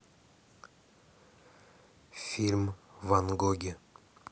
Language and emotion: Russian, neutral